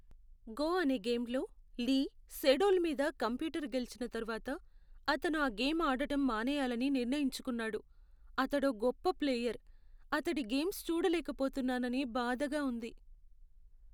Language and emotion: Telugu, sad